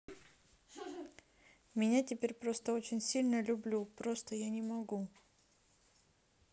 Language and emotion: Russian, neutral